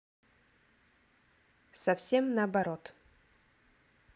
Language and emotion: Russian, neutral